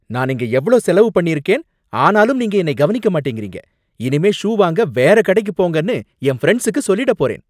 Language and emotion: Tamil, angry